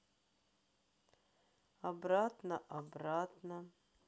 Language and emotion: Russian, sad